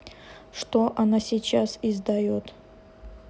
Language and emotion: Russian, neutral